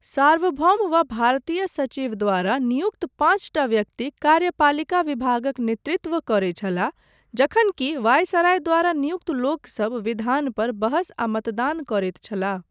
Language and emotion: Maithili, neutral